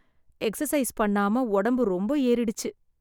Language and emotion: Tamil, sad